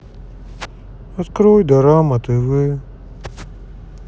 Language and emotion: Russian, sad